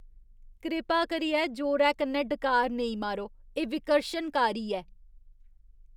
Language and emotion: Dogri, disgusted